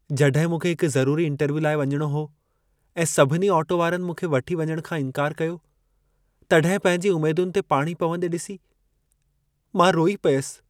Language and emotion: Sindhi, sad